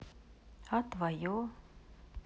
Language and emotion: Russian, neutral